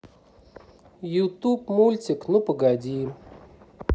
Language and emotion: Russian, neutral